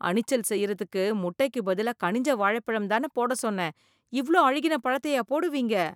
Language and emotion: Tamil, disgusted